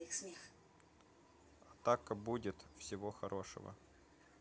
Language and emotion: Russian, neutral